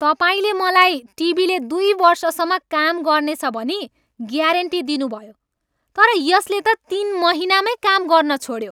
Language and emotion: Nepali, angry